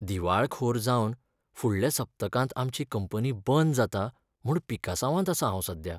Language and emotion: Goan Konkani, sad